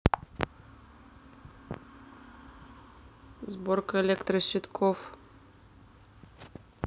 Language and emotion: Russian, neutral